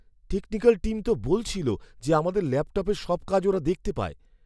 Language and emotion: Bengali, fearful